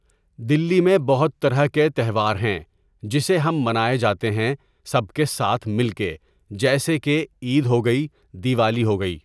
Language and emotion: Urdu, neutral